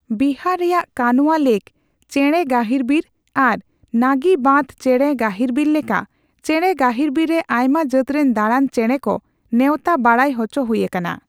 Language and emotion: Santali, neutral